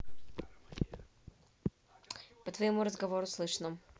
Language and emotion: Russian, neutral